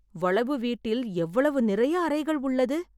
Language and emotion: Tamil, surprised